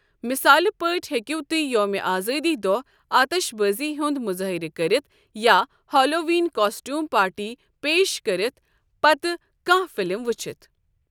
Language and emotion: Kashmiri, neutral